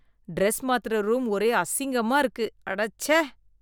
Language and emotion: Tamil, disgusted